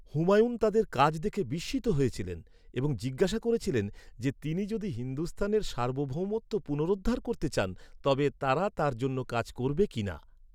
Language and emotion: Bengali, neutral